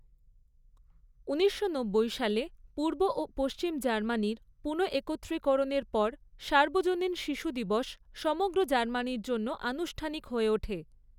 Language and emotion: Bengali, neutral